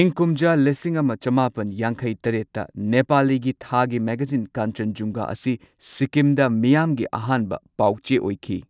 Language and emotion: Manipuri, neutral